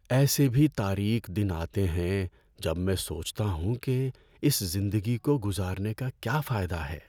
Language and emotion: Urdu, sad